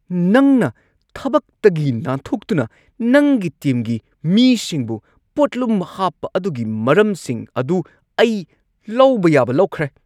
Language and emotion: Manipuri, angry